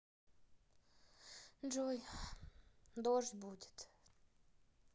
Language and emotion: Russian, sad